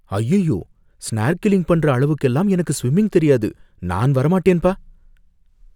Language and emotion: Tamil, fearful